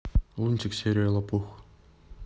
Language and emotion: Russian, neutral